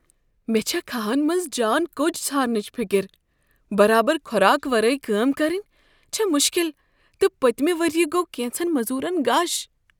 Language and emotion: Kashmiri, fearful